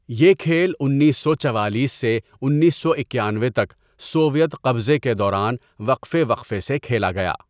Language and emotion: Urdu, neutral